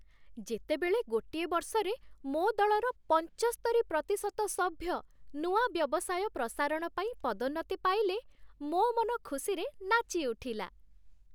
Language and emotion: Odia, happy